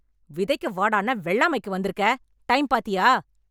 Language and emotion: Tamil, angry